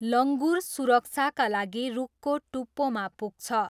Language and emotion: Nepali, neutral